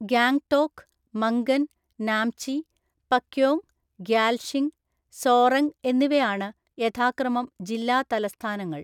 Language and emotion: Malayalam, neutral